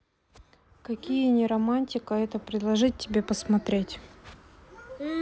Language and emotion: Russian, neutral